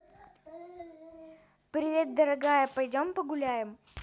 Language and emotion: Russian, positive